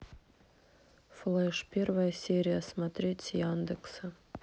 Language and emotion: Russian, neutral